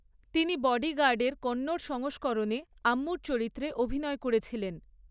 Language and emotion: Bengali, neutral